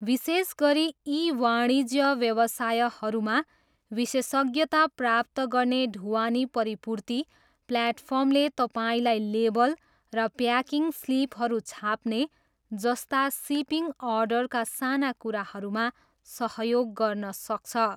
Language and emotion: Nepali, neutral